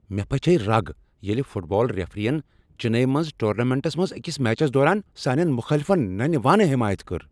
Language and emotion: Kashmiri, angry